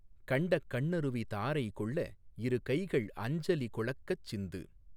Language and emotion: Tamil, neutral